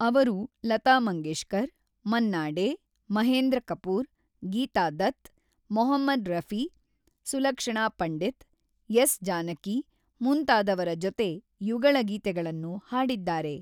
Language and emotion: Kannada, neutral